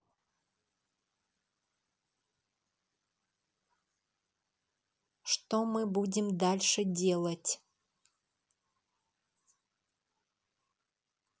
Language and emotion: Russian, neutral